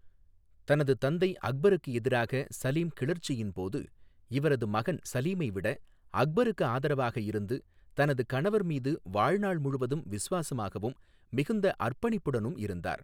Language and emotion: Tamil, neutral